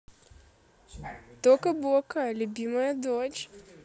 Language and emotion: Russian, positive